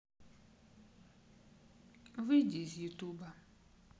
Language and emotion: Russian, sad